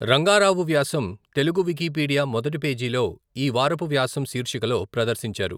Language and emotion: Telugu, neutral